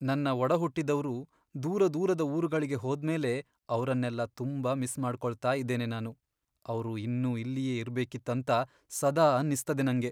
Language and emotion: Kannada, sad